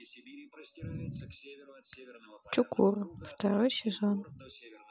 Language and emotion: Russian, neutral